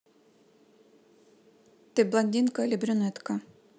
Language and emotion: Russian, neutral